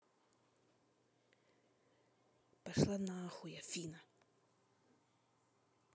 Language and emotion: Russian, angry